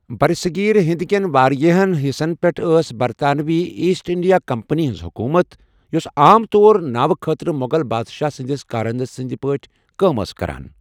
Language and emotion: Kashmiri, neutral